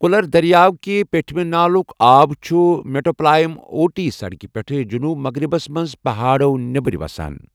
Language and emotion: Kashmiri, neutral